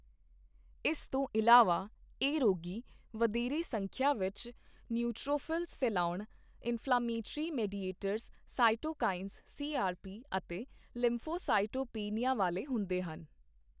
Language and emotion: Punjabi, neutral